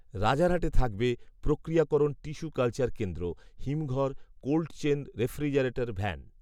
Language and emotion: Bengali, neutral